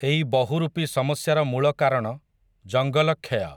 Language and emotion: Odia, neutral